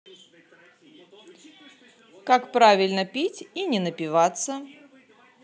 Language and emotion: Russian, positive